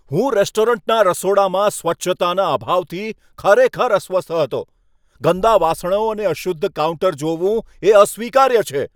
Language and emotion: Gujarati, angry